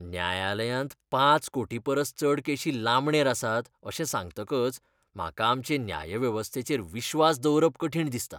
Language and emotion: Goan Konkani, disgusted